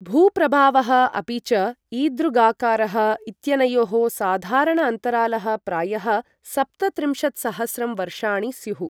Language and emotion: Sanskrit, neutral